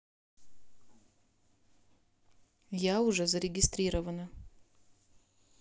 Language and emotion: Russian, neutral